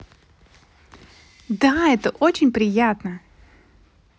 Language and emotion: Russian, positive